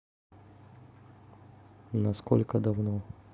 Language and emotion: Russian, neutral